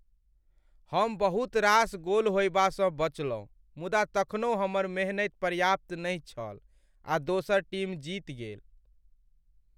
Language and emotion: Maithili, sad